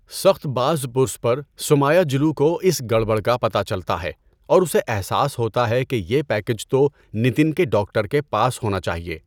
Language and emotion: Urdu, neutral